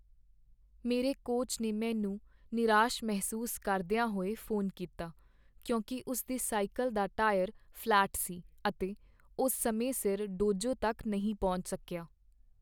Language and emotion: Punjabi, sad